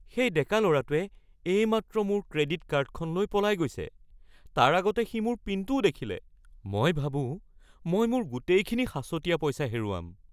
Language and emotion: Assamese, fearful